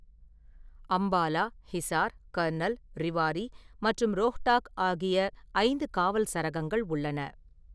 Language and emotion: Tamil, neutral